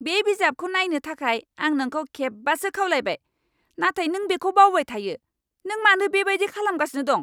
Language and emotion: Bodo, angry